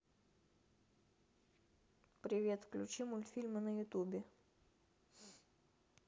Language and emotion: Russian, neutral